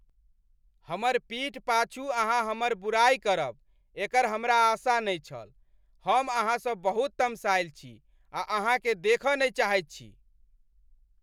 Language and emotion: Maithili, angry